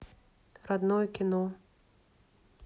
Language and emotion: Russian, neutral